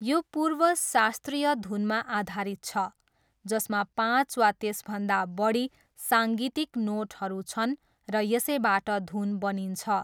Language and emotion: Nepali, neutral